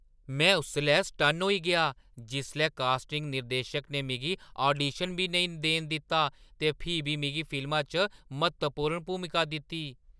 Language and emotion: Dogri, surprised